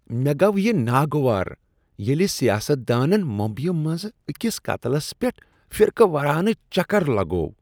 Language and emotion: Kashmiri, disgusted